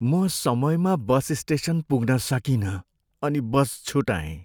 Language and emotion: Nepali, sad